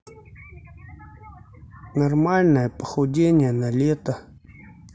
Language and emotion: Russian, neutral